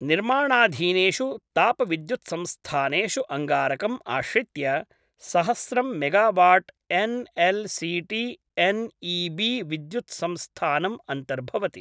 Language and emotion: Sanskrit, neutral